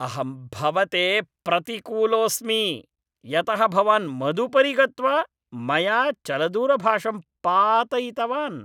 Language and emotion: Sanskrit, angry